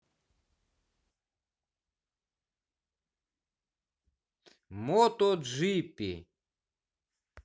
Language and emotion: Russian, positive